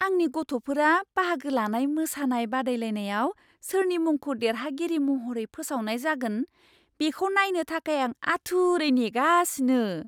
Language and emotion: Bodo, surprised